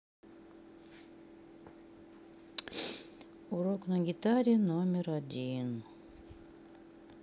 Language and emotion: Russian, sad